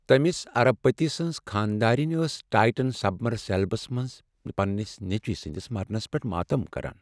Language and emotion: Kashmiri, sad